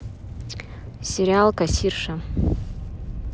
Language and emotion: Russian, neutral